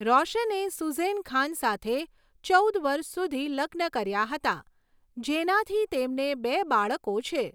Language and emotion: Gujarati, neutral